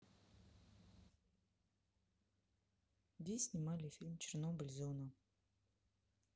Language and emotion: Russian, neutral